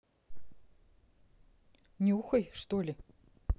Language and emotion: Russian, neutral